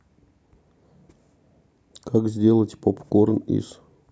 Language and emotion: Russian, neutral